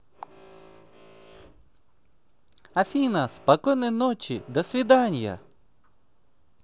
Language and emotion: Russian, positive